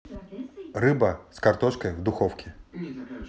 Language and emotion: Russian, neutral